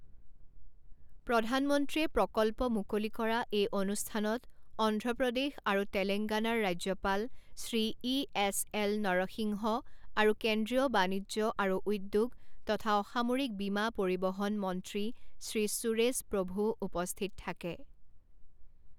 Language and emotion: Assamese, neutral